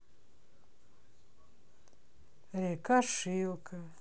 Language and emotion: Russian, sad